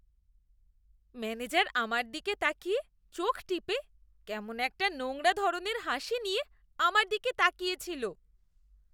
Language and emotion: Bengali, disgusted